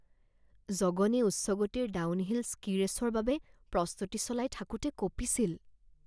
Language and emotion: Assamese, fearful